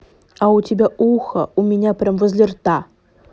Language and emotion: Russian, angry